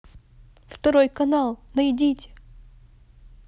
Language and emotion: Russian, neutral